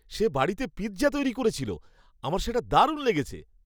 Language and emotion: Bengali, happy